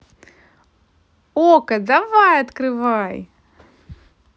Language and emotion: Russian, positive